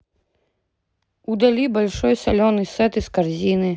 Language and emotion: Russian, neutral